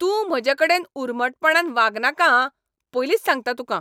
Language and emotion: Goan Konkani, angry